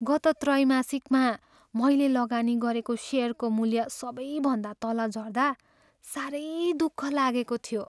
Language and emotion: Nepali, sad